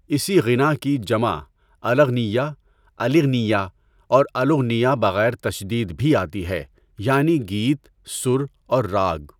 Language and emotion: Urdu, neutral